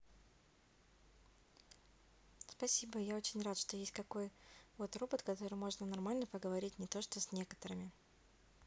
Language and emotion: Russian, neutral